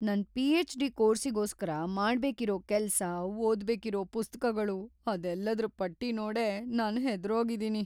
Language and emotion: Kannada, fearful